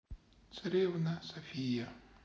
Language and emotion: Russian, sad